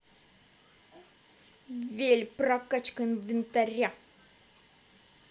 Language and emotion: Russian, angry